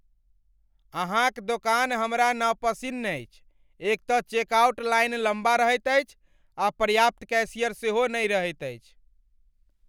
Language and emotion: Maithili, angry